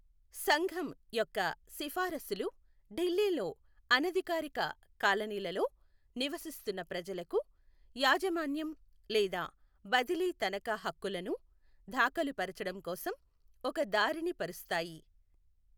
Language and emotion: Telugu, neutral